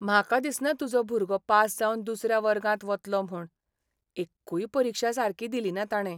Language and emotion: Goan Konkani, sad